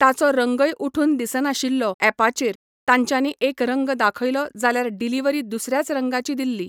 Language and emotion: Goan Konkani, neutral